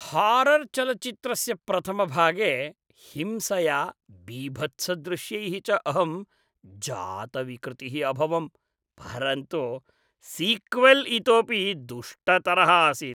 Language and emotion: Sanskrit, disgusted